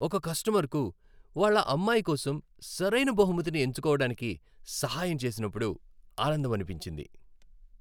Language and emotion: Telugu, happy